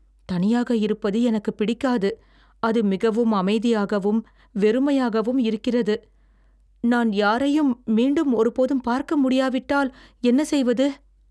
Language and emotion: Tamil, fearful